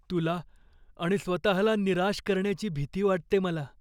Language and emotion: Marathi, fearful